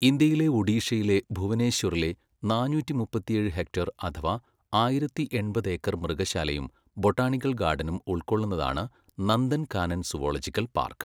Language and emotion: Malayalam, neutral